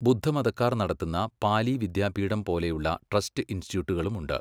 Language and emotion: Malayalam, neutral